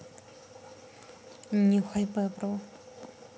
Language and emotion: Russian, neutral